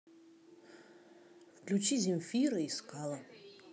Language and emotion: Russian, neutral